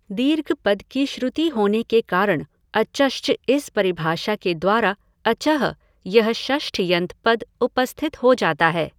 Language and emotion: Hindi, neutral